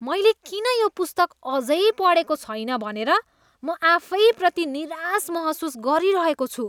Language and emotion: Nepali, disgusted